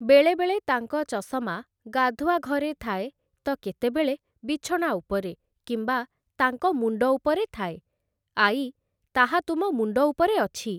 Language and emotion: Odia, neutral